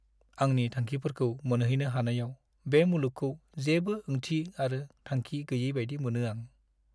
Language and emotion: Bodo, sad